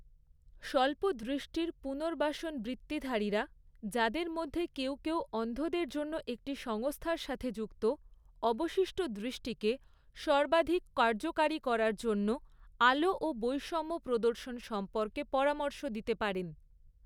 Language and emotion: Bengali, neutral